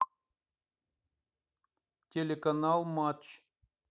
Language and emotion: Russian, neutral